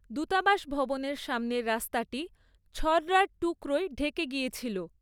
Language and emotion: Bengali, neutral